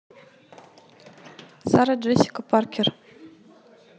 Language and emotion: Russian, neutral